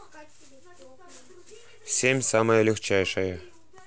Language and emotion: Russian, neutral